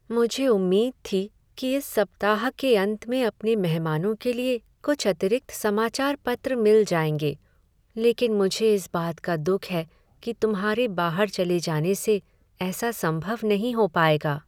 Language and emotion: Hindi, sad